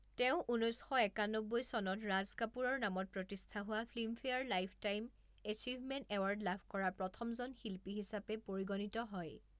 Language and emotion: Assamese, neutral